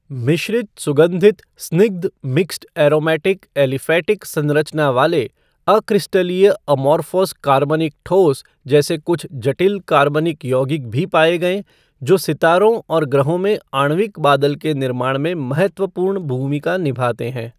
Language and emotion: Hindi, neutral